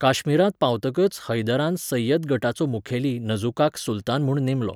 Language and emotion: Goan Konkani, neutral